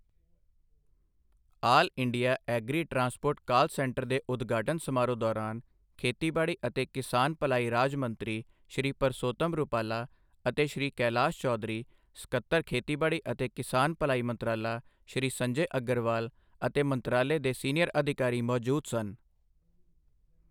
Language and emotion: Punjabi, neutral